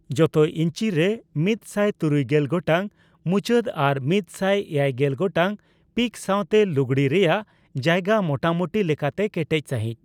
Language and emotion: Santali, neutral